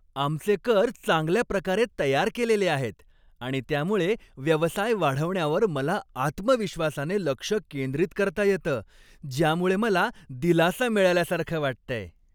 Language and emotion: Marathi, happy